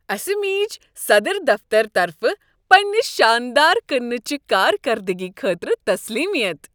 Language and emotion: Kashmiri, happy